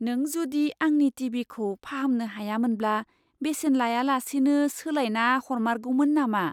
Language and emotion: Bodo, surprised